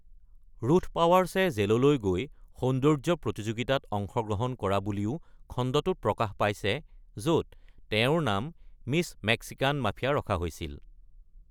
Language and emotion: Assamese, neutral